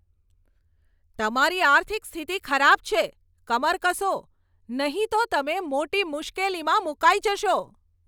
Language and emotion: Gujarati, angry